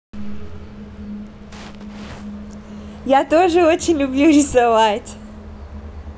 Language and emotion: Russian, positive